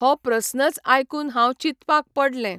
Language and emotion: Goan Konkani, neutral